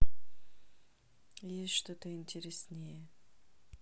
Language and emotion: Russian, neutral